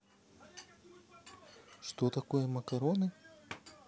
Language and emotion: Russian, neutral